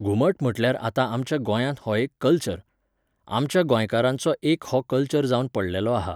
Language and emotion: Goan Konkani, neutral